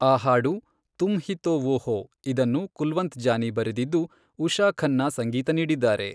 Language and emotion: Kannada, neutral